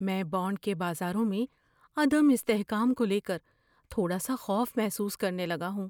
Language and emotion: Urdu, fearful